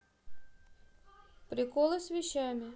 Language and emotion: Russian, neutral